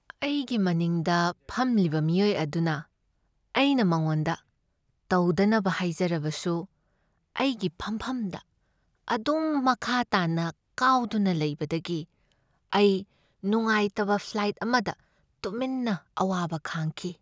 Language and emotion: Manipuri, sad